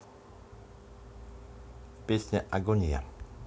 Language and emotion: Russian, neutral